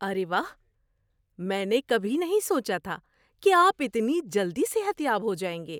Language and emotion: Urdu, surprised